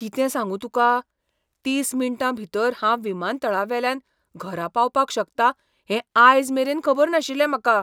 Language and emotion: Goan Konkani, surprised